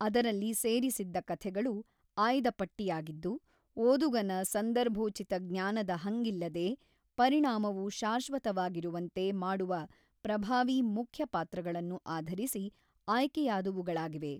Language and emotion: Kannada, neutral